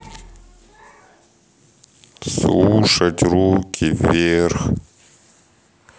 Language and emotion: Russian, neutral